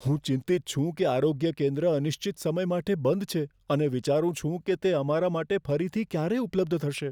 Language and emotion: Gujarati, fearful